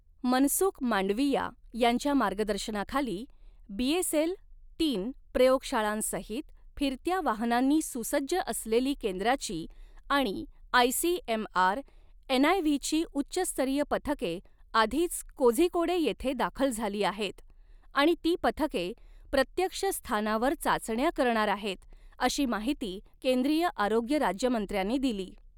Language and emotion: Marathi, neutral